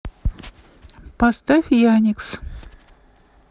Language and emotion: Russian, neutral